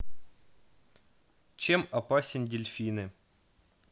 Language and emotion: Russian, neutral